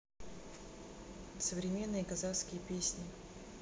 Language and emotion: Russian, neutral